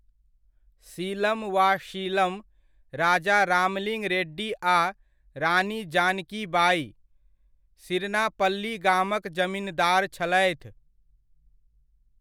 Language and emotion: Maithili, neutral